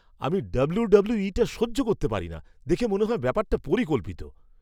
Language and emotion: Bengali, disgusted